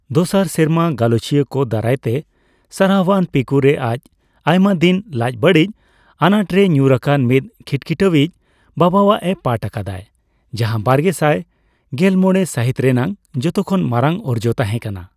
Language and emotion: Santali, neutral